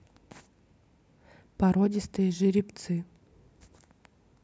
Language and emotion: Russian, neutral